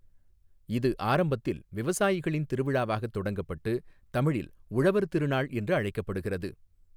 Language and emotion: Tamil, neutral